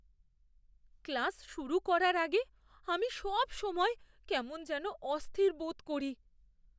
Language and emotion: Bengali, fearful